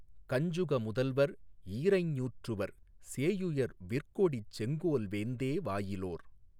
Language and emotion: Tamil, neutral